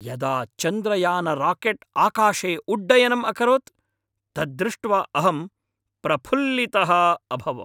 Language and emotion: Sanskrit, happy